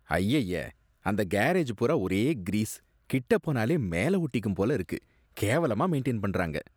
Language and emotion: Tamil, disgusted